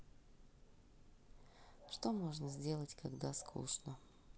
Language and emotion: Russian, sad